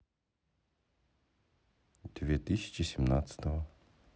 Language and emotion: Russian, neutral